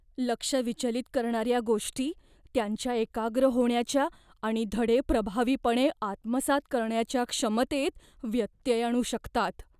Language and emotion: Marathi, fearful